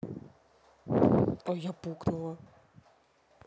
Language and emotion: Russian, neutral